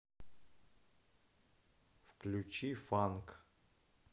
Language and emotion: Russian, neutral